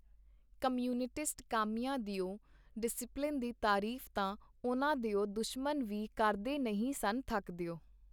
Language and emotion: Punjabi, neutral